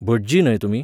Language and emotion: Goan Konkani, neutral